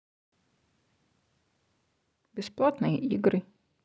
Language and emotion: Russian, neutral